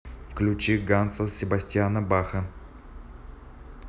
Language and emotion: Russian, neutral